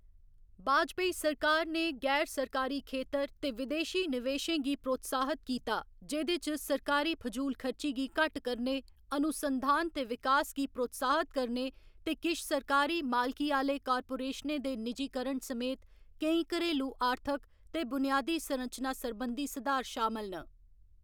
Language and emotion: Dogri, neutral